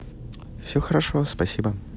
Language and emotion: Russian, neutral